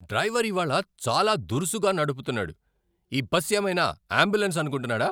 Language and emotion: Telugu, angry